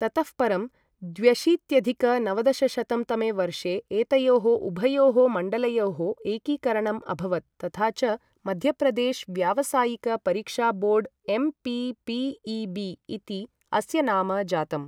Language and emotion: Sanskrit, neutral